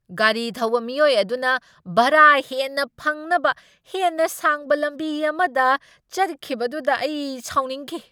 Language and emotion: Manipuri, angry